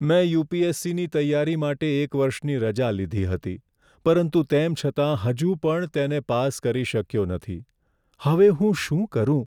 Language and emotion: Gujarati, sad